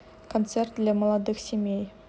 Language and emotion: Russian, neutral